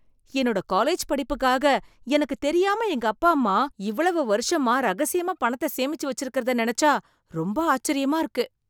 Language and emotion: Tamil, surprised